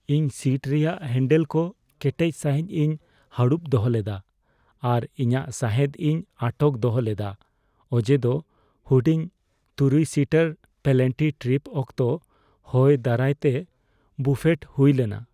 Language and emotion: Santali, fearful